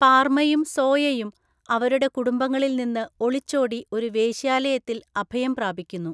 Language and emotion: Malayalam, neutral